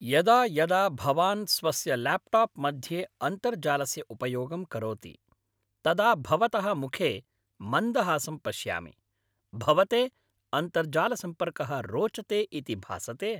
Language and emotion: Sanskrit, happy